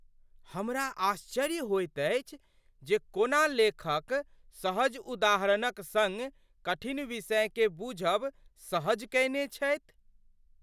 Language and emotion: Maithili, surprised